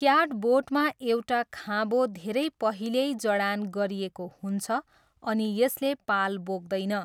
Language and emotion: Nepali, neutral